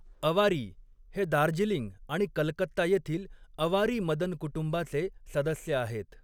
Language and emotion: Marathi, neutral